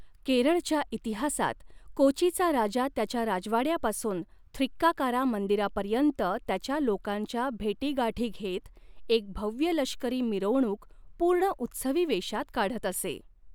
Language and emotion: Marathi, neutral